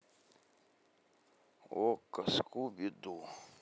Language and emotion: Russian, neutral